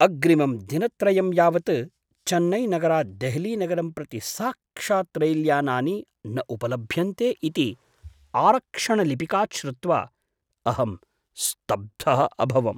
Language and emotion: Sanskrit, surprised